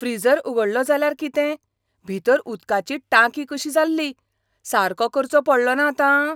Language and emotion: Goan Konkani, surprised